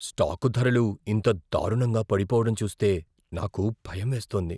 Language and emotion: Telugu, fearful